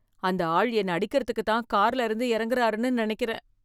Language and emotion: Tamil, fearful